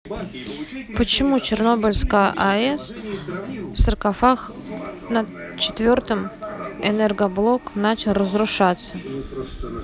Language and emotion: Russian, neutral